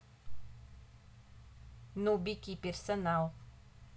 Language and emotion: Russian, neutral